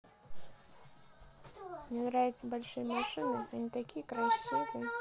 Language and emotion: Russian, neutral